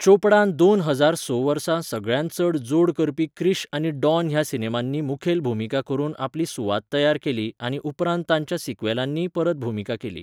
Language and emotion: Goan Konkani, neutral